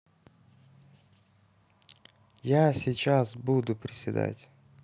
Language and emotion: Russian, neutral